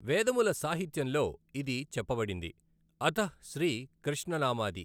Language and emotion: Telugu, neutral